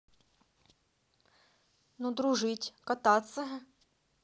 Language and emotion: Russian, positive